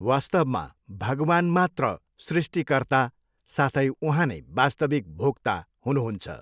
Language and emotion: Nepali, neutral